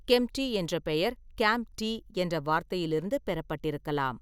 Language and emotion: Tamil, neutral